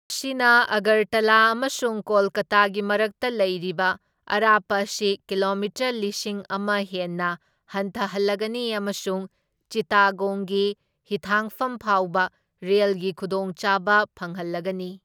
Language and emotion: Manipuri, neutral